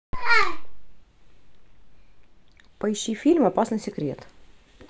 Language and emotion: Russian, neutral